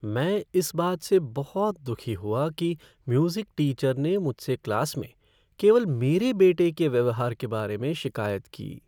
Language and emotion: Hindi, sad